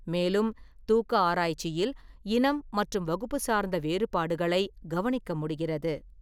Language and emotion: Tamil, neutral